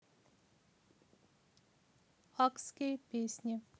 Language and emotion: Russian, neutral